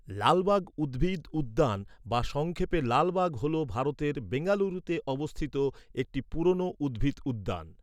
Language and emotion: Bengali, neutral